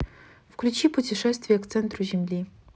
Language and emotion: Russian, neutral